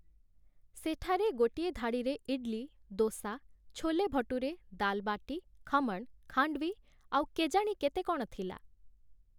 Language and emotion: Odia, neutral